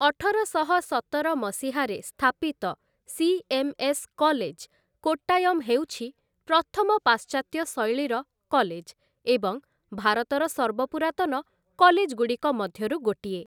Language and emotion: Odia, neutral